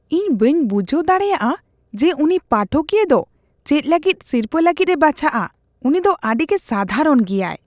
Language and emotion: Santali, disgusted